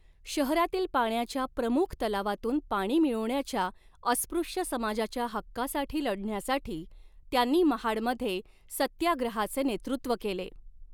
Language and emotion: Marathi, neutral